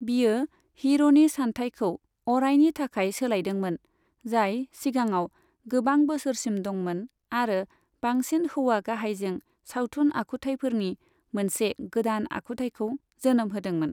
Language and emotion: Bodo, neutral